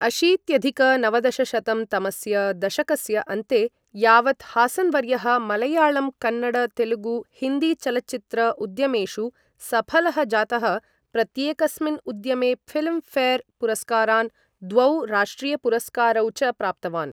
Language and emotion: Sanskrit, neutral